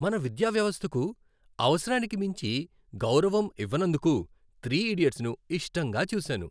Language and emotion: Telugu, happy